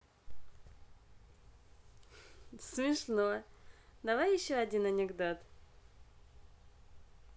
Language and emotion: Russian, positive